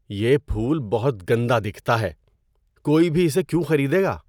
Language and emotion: Urdu, disgusted